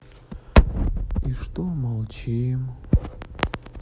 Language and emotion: Russian, sad